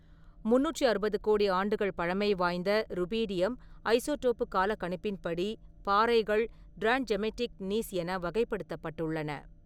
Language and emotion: Tamil, neutral